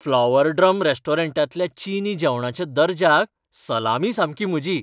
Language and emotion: Goan Konkani, happy